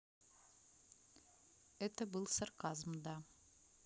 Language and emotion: Russian, neutral